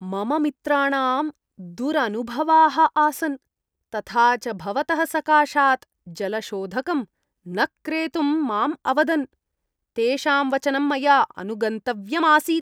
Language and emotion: Sanskrit, disgusted